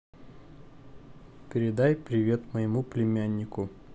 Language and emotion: Russian, neutral